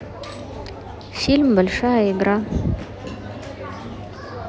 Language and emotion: Russian, neutral